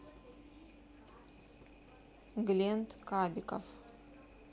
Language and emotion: Russian, neutral